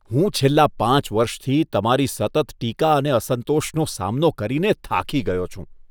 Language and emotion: Gujarati, disgusted